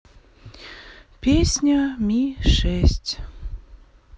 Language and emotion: Russian, sad